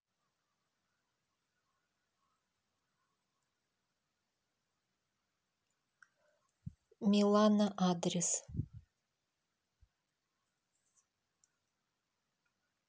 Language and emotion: Russian, neutral